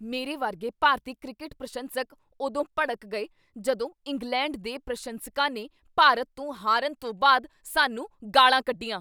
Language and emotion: Punjabi, angry